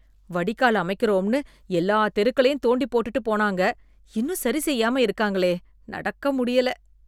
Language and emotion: Tamil, disgusted